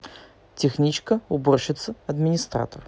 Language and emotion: Russian, neutral